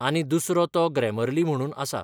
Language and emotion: Goan Konkani, neutral